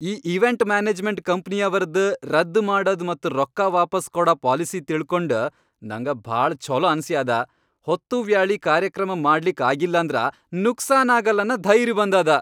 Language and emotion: Kannada, happy